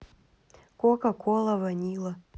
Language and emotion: Russian, neutral